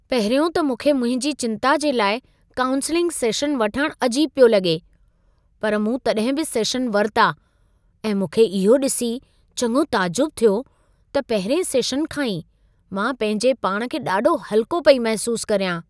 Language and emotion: Sindhi, surprised